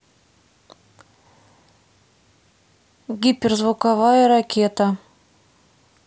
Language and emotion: Russian, neutral